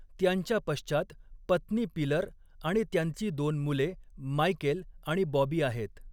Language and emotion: Marathi, neutral